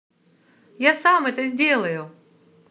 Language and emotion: Russian, positive